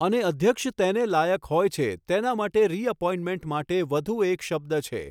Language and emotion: Gujarati, neutral